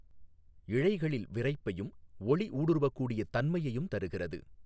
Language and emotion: Tamil, neutral